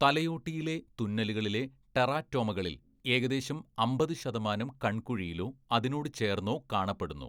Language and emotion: Malayalam, neutral